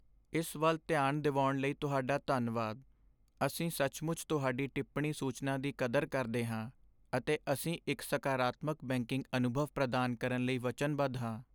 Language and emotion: Punjabi, sad